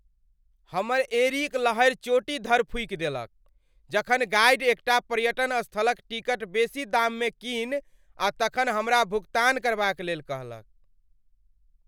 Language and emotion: Maithili, angry